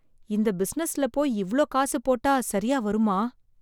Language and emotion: Tamil, fearful